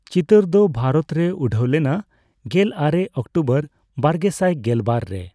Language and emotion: Santali, neutral